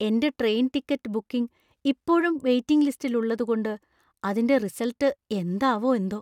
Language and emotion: Malayalam, fearful